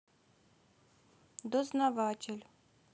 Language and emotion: Russian, neutral